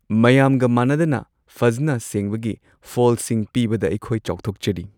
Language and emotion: Manipuri, happy